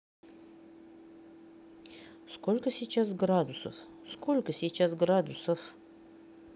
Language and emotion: Russian, neutral